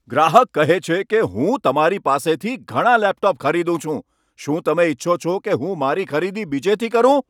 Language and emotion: Gujarati, angry